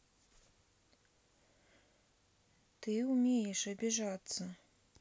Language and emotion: Russian, sad